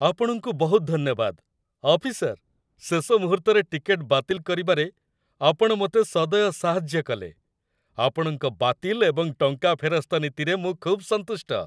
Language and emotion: Odia, happy